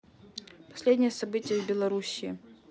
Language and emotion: Russian, neutral